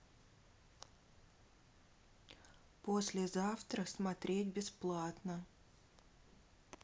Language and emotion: Russian, neutral